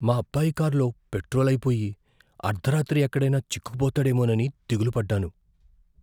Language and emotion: Telugu, fearful